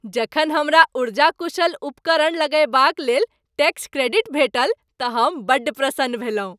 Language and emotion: Maithili, happy